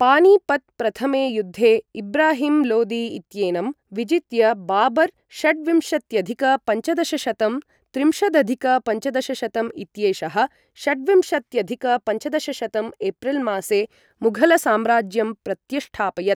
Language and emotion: Sanskrit, neutral